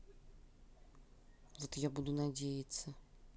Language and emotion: Russian, neutral